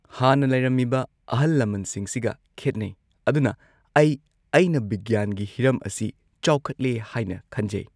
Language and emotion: Manipuri, neutral